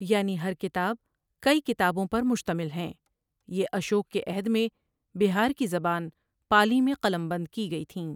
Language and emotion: Urdu, neutral